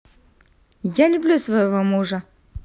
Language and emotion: Russian, positive